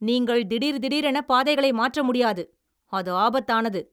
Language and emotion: Tamil, angry